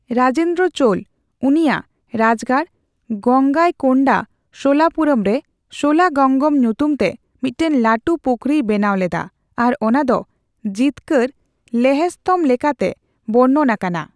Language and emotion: Santali, neutral